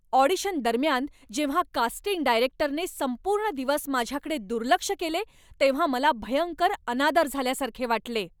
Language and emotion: Marathi, angry